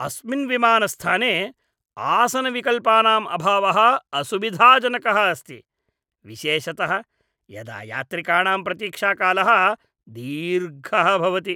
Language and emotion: Sanskrit, disgusted